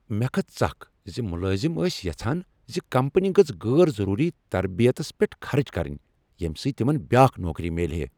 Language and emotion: Kashmiri, angry